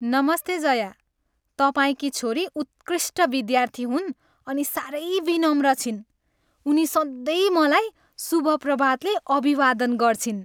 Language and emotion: Nepali, happy